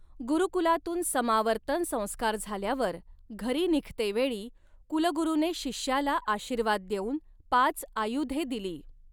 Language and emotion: Marathi, neutral